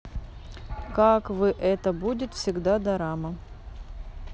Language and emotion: Russian, neutral